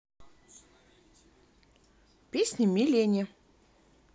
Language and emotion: Russian, neutral